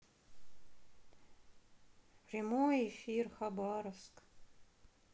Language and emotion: Russian, sad